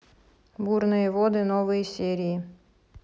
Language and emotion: Russian, neutral